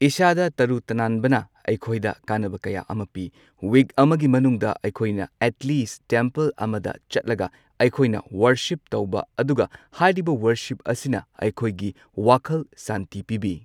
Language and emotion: Manipuri, neutral